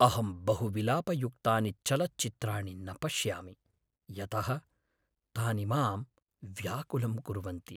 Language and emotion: Sanskrit, sad